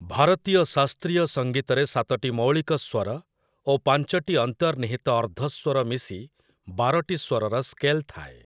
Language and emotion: Odia, neutral